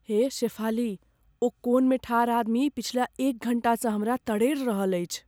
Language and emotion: Maithili, fearful